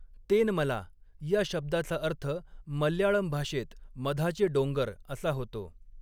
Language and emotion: Marathi, neutral